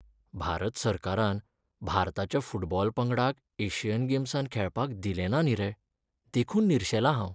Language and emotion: Goan Konkani, sad